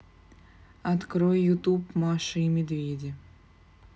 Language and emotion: Russian, neutral